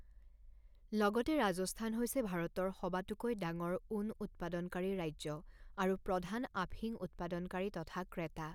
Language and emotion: Assamese, neutral